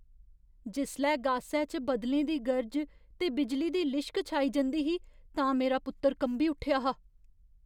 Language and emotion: Dogri, fearful